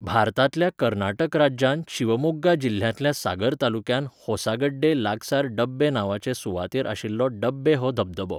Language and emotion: Goan Konkani, neutral